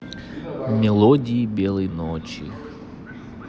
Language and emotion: Russian, neutral